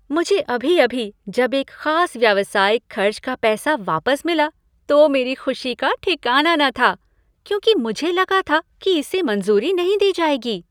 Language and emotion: Hindi, happy